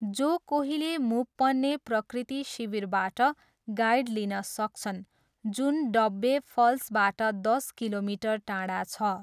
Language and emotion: Nepali, neutral